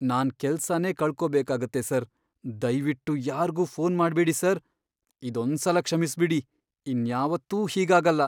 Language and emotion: Kannada, fearful